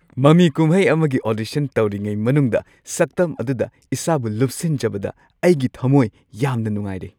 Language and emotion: Manipuri, happy